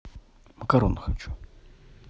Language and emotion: Russian, neutral